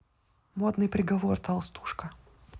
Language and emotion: Russian, neutral